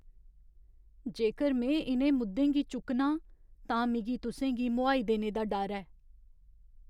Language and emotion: Dogri, fearful